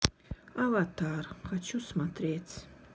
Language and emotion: Russian, sad